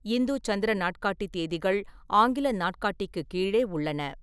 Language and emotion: Tamil, neutral